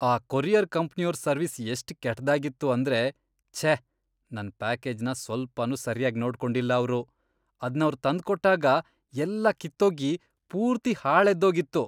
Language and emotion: Kannada, disgusted